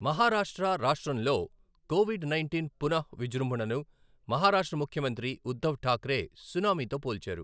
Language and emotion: Telugu, neutral